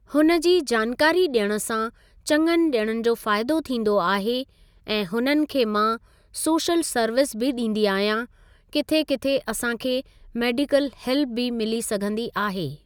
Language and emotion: Sindhi, neutral